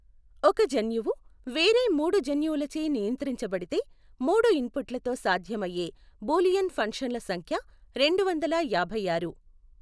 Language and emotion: Telugu, neutral